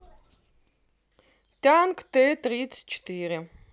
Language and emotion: Russian, neutral